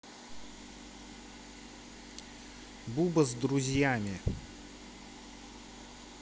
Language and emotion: Russian, neutral